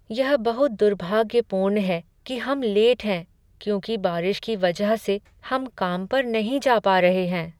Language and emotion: Hindi, sad